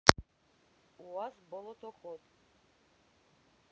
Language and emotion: Russian, neutral